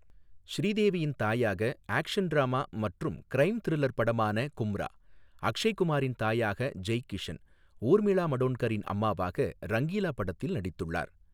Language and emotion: Tamil, neutral